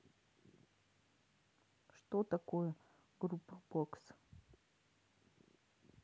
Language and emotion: Russian, neutral